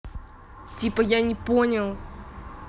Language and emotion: Russian, angry